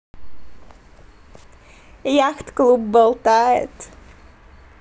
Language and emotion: Russian, positive